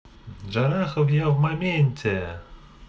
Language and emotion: Russian, positive